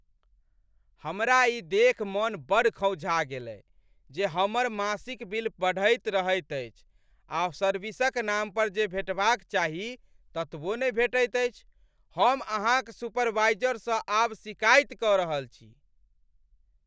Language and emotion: Maithili, angry